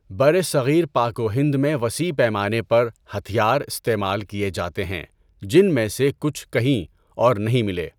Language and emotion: Urdu, neutral